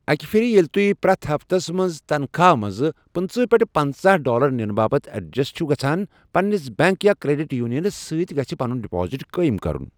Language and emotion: Kashmiri, neutral